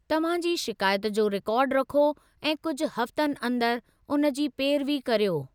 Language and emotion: Sindhi, neutral